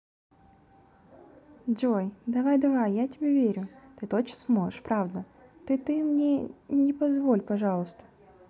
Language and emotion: Russian, positive